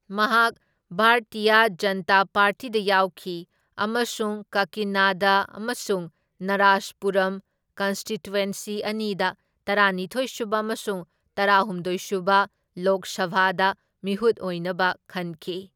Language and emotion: Manipuri, neutral